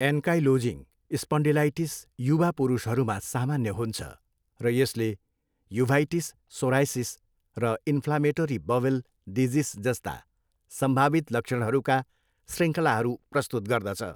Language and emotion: Nepali, neutral